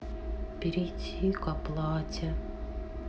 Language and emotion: Russian, sad